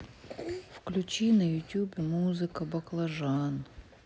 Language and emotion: Russian, sad